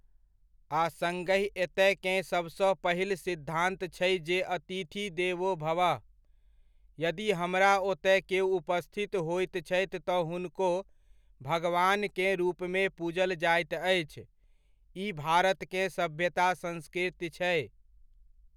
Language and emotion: Maithili, neutral